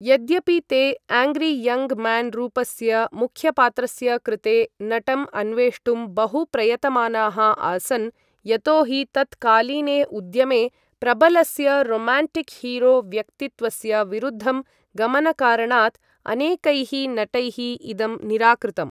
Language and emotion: Sanskrit, neutral